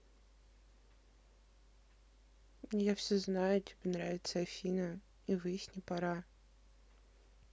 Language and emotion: Russian, neutral